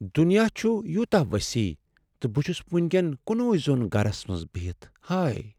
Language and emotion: Kashmiri, sad